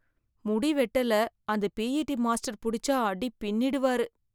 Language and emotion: Tamil, fearful